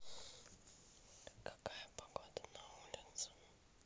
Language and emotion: Russian, neutral